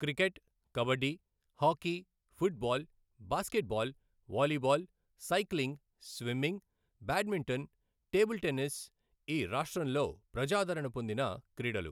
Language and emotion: Telugu, neutral